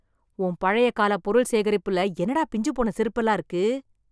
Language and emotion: Tamil, disgusted